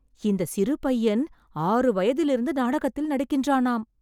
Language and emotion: Tamil, surprised